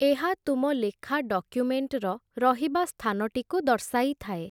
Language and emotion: Odia, neutral